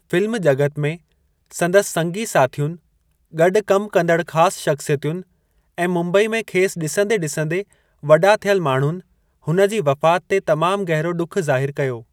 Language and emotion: Sindhi, neutral